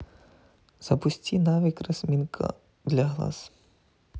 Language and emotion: Russian, neutral